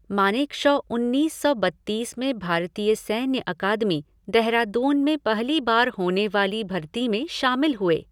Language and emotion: Hindi, neutral